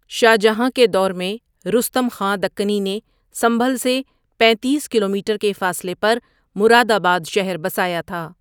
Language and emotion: Urdu, neutral